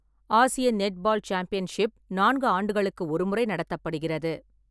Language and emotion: Tamil, neutral